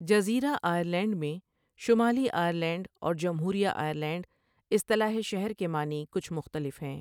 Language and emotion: Urdu, neutral